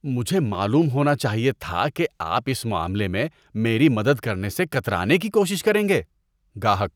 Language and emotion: Urdu, disgusted